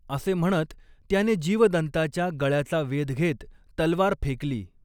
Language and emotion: Marathi, neutral